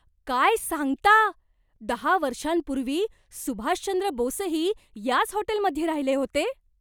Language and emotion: Marathi, surprised